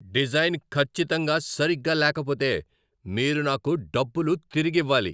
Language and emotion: Telugu, angry